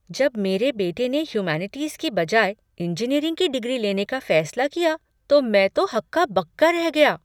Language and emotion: Hindi, surprised